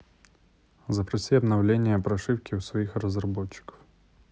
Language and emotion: Russian, neutral